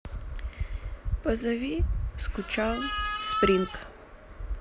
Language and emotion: Russian, sad